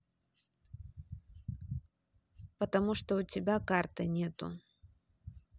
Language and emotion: Russian, neutral